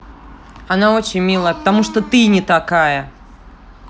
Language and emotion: Russian, angry